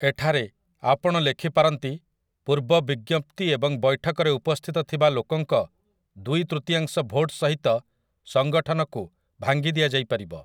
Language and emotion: Odia, neutral